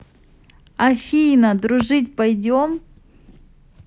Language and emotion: Russian, positive